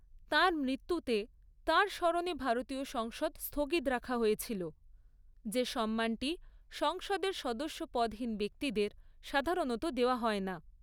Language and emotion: Bengali, neutral